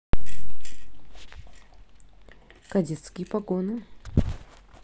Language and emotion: Russian, neutral